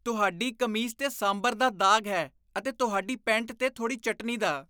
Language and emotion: Punjabi, disgusted